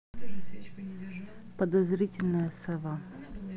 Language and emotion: Russian, neutral